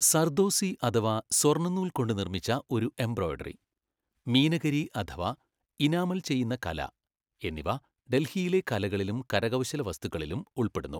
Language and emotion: Malayalam, neutral